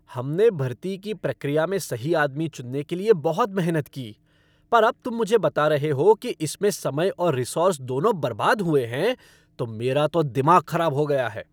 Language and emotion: Hindi, angry